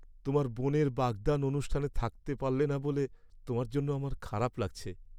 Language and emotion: Bengali, sad